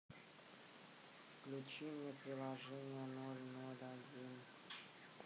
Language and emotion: Russian, sad